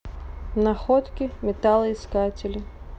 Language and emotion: Russian, neutral